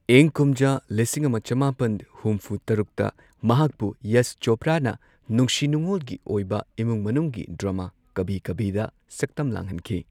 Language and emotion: Manipuri, neutral